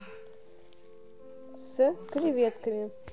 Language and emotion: Russian, neutral